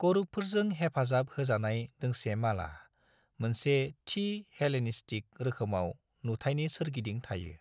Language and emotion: Bodo, neutral